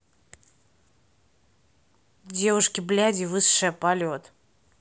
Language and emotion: Russian, neutral